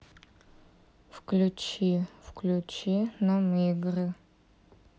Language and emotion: Russian, neutral